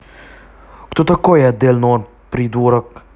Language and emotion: Russian, angry